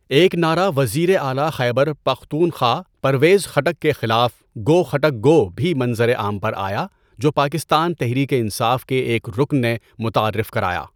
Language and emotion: Urdu, neutral